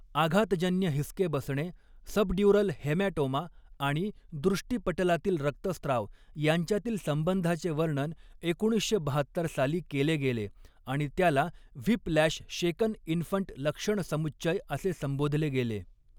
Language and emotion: Marathi, neutral